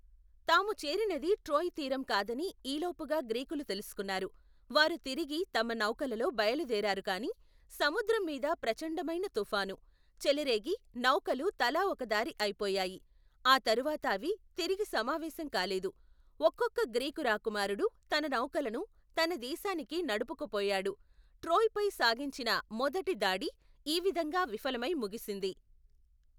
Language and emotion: Telugu, neutral